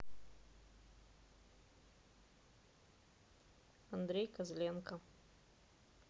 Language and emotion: Russian, neutral